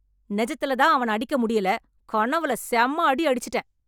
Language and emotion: Tamil, angry